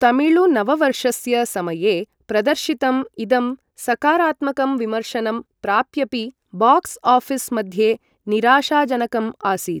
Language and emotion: Sanskrit, neutral